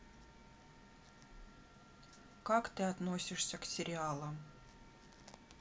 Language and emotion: Russian, neutral